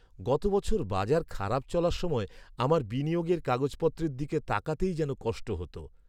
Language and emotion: Bengali, sad